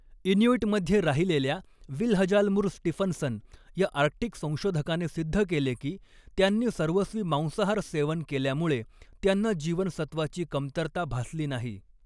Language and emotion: Marathi, neutral